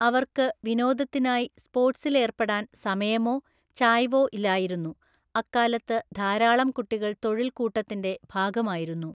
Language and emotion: Malayalam, neutral